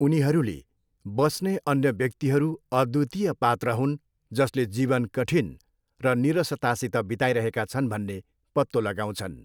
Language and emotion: Nepali, neutral